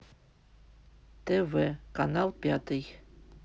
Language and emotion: Russian, neutral